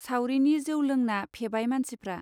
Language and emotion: Bodo, neutral